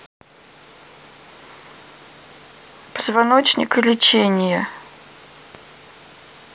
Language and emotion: Russian, neutral